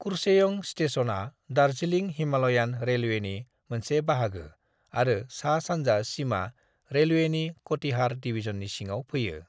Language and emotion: Bodo, neutral